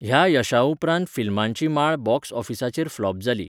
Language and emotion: Goan Konkani, neutral